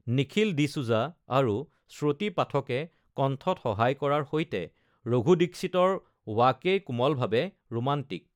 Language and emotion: Assamese, neutral